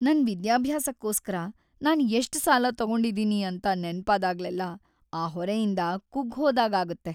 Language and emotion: Kannada, sad